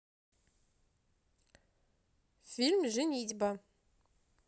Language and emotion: Russian, positive